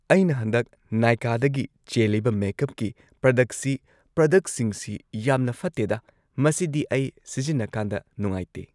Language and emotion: Manipuri, neutral